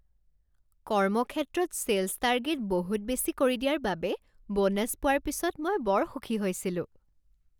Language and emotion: Assamese, happy